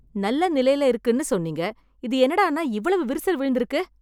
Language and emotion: Tamil, angry